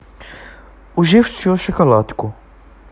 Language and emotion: Russian, neutral